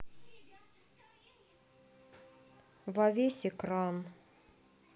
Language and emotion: Russian, sad